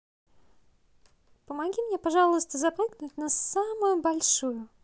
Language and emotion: Russian, positive